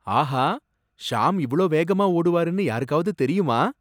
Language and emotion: Tamil, surprised